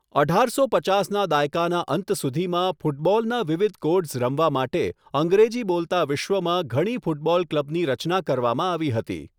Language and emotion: Gujarati, neutral